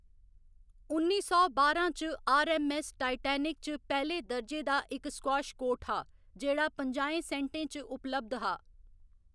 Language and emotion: Dogri, neutral